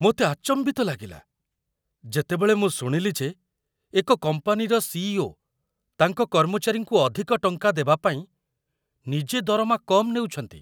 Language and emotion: Odia, surprised